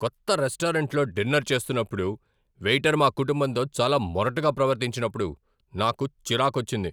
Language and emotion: Telugu, angry